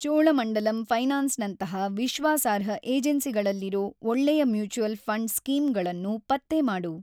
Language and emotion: Kannada, neutral